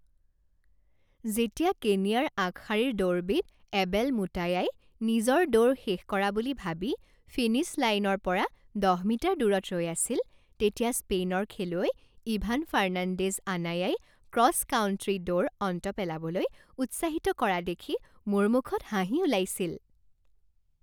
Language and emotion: Assamese, happy